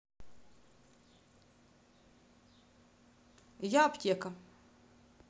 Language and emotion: Russian, neutral